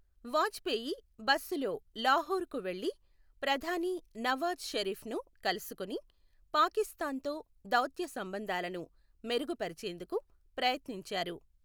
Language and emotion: Telugu, neutral